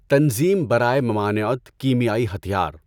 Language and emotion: Urdu, neutral